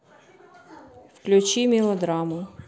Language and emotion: Russian, neutral